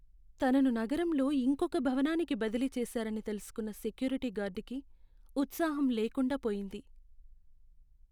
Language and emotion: Telugu, sad